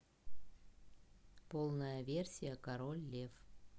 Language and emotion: Russian, neutral